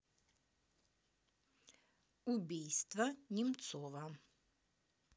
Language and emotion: Russian, neutral